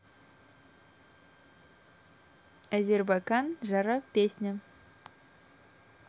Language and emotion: Russian, neutral